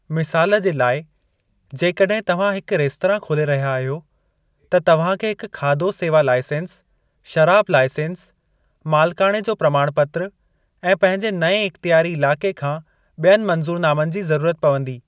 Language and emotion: Sindhi, neutral